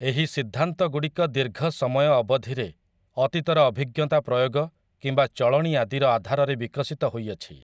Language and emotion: Odia, neutral